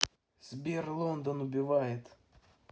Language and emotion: Russian, neutral